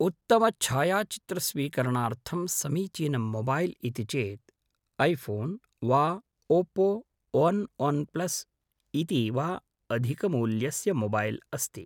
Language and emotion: Sanskrit, neutral